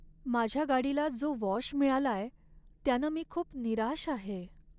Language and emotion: Marathi, sad